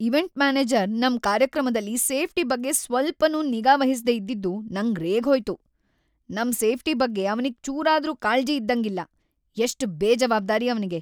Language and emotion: Kannada, angry